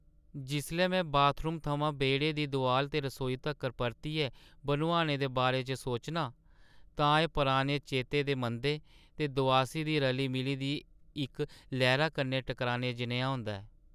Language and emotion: Dogri, sad